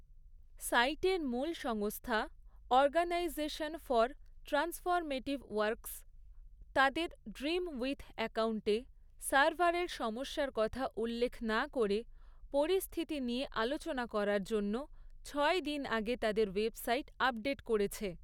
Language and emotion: Bengali, neutral